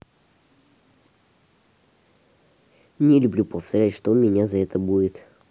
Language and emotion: Russian, neutral